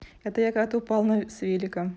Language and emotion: Russian, positive